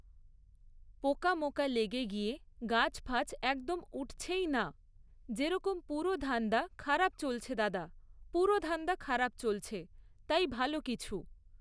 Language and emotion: Bengali, neutral